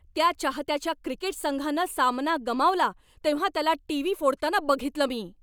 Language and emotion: Marathi, angry